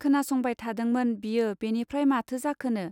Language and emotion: Bodo, neutral